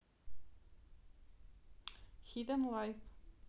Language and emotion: Russian, neutral